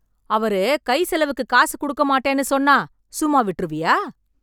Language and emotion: Tamil, angry